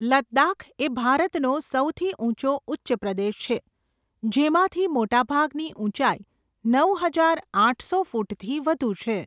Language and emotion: Gujarati, neutral